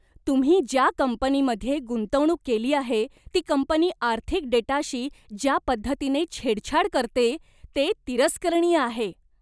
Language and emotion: Marathi, disgusted